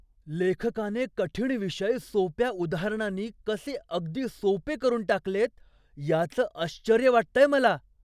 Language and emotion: Marathi, surprised